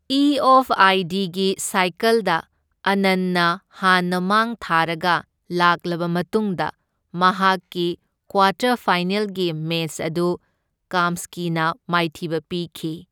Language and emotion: Manipuri, neutral